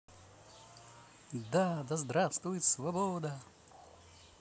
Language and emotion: Russian, positive